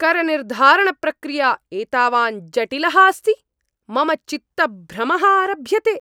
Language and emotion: Sanskrit, angry